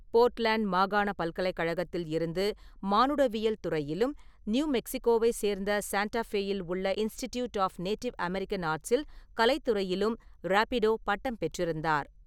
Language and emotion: Tamil, neutral